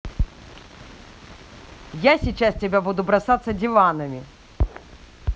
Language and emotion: Russian, angry